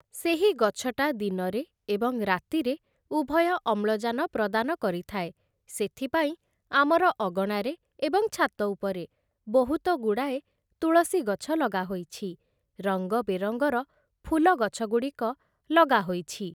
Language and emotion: Odia, neutral